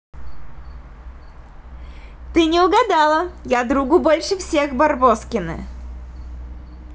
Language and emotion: Russian, positive